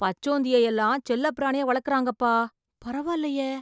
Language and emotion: Tamil, surprised